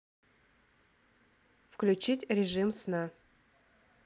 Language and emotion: Russian, neutral